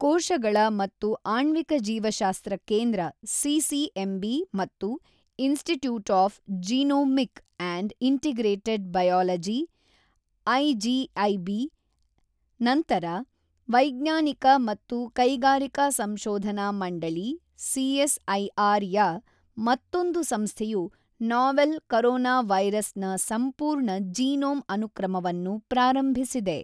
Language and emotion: Kannada, neutral